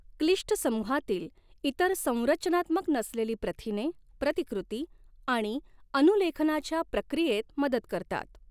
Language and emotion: Marathi, neutral